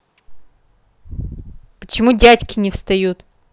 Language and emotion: Russian, angry